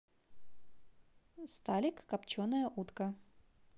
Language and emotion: Russian, positive